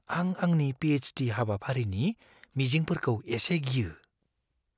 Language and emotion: Bodo, fearful